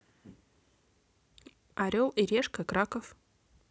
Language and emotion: Russian, neutral